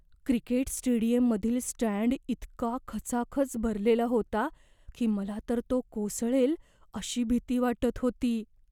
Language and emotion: Marathi, fearful